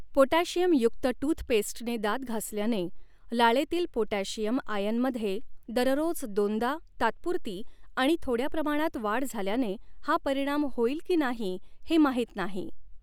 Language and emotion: Marathi, neutral